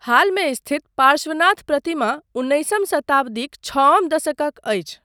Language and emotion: Maithili, neutral